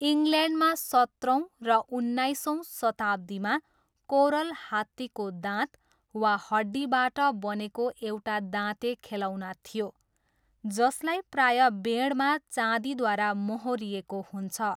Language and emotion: Nepali, neutral